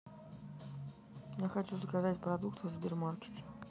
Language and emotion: Russian, neutral